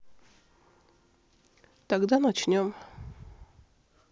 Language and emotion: Russian, neutral